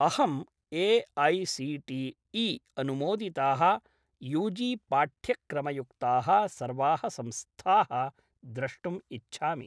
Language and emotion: Sanskrit, neutral